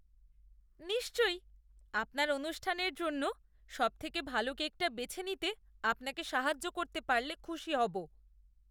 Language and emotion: Bengali, disgusted